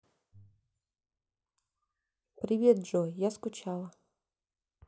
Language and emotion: Russian, sad